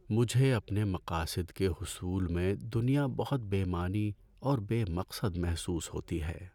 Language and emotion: Urdu, sad